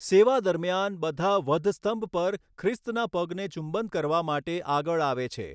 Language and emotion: Gujarati, neutral